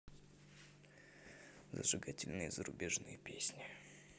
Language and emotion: Russian, neutral